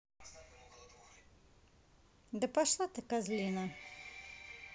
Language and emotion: Russian, angry